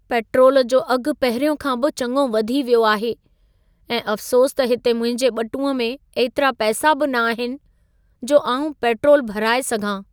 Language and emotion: Sindhi, sad